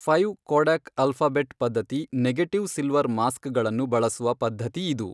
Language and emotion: Kannada, neutral